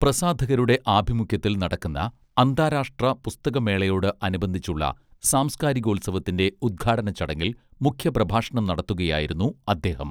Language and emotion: Malayalam, neutral